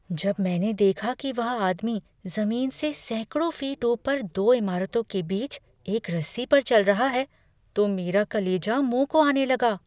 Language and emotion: Hindi, fearful